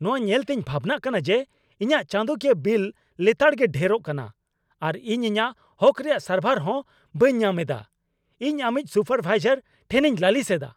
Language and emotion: Santali, angry